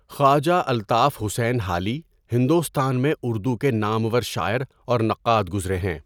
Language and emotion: Urdu, neutral